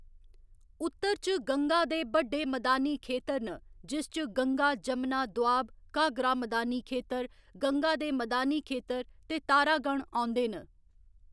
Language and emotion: Dogri, neutral